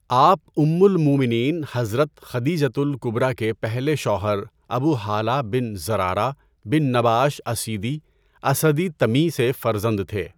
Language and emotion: Urdu, neutral